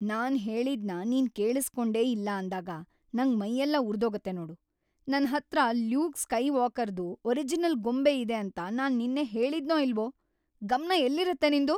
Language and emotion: Kannada, angry